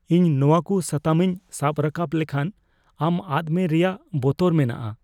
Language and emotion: Santali, fearful